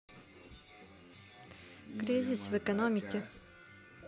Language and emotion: Russian, neutral